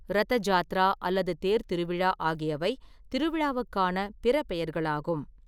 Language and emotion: Tamil, neutral